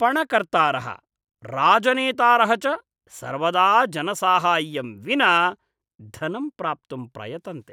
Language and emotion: Sanskrit, disgusted